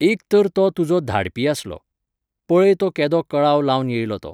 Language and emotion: Goan Konkani, neutral